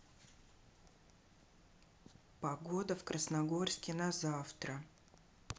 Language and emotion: Russian, neutral